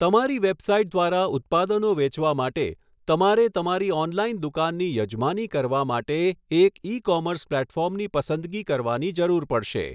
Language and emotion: Gujarati, neutral